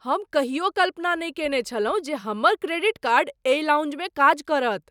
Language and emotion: Maithili, surprised